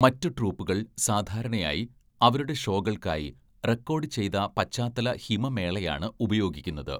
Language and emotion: Malayalam, neutral